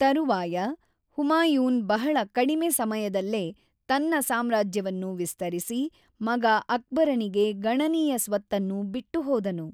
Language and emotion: Kannada, neutral